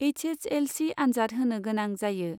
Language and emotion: Bodo, neutral